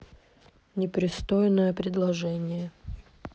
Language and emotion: Russian, neutral